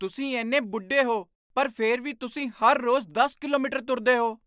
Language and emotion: Punjabi, surprised